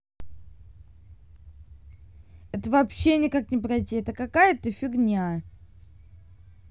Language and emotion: Russian, angry